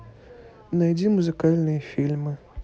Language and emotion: Russian, neutral